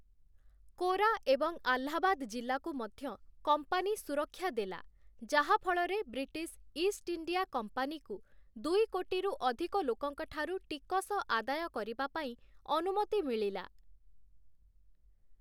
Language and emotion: Odia, neutral